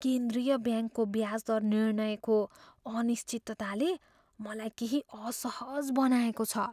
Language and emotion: Nepali, fearful